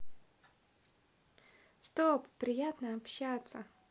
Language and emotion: Russian, positive